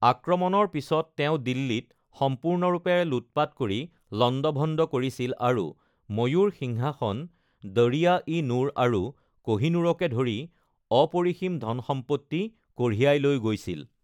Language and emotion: Assamese, neutral